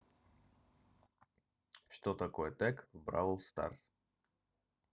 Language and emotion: Russian, neutral